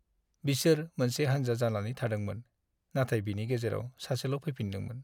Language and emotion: Bodo, sad